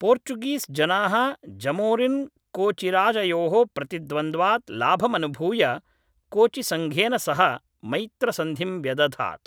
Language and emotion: Sanskrit, neutral